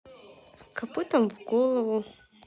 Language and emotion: Russian, neutral